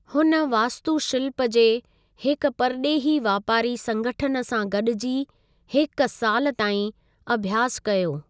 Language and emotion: Sindhi, neutral